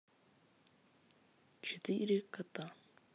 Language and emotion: Russian, neutral